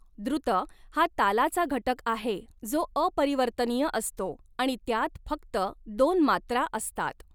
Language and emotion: Marathi, neutral